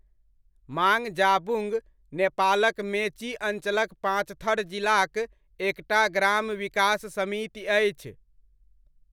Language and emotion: Maithili, neutral